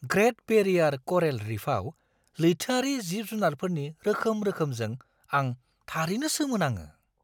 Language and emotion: Bodo, surprised